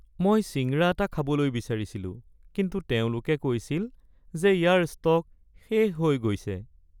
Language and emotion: Assamese, sad